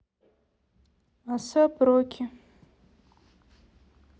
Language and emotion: Russian, neutral